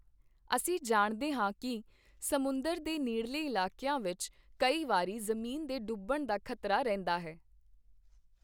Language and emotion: Punjabi, neutral